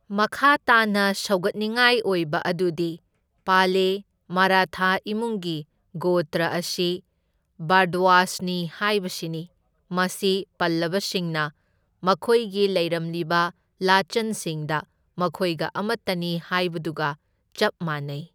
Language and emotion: Manipuri, neutral